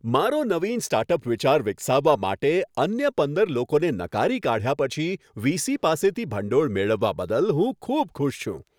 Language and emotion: Gujarati, happy